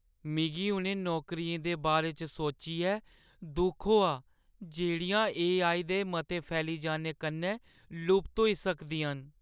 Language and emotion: Dogri, sad